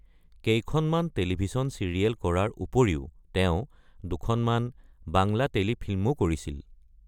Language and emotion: Assamese, neutral